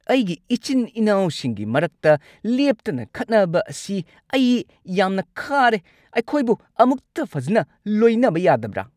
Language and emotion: Manipuri, angry